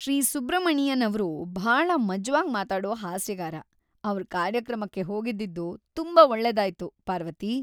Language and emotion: Kannada, happy